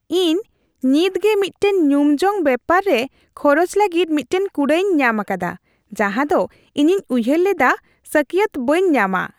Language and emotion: Santali, happy